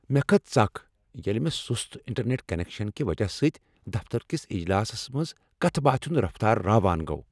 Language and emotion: Kashmiri, angry